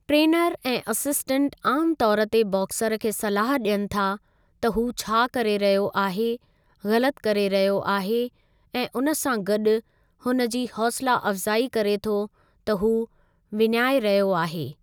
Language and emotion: Sindhi, neutral